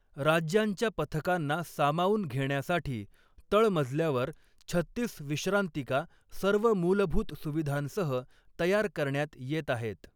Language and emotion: Marathi, neutral